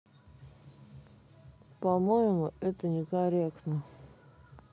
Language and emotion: Russian, neutral